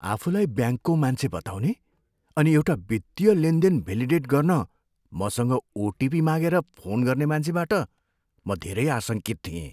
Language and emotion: Nepali, fearful